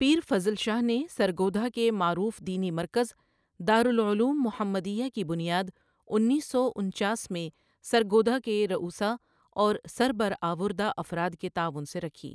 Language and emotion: Urdu, neutral